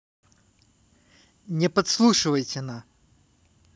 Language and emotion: Russian, neutral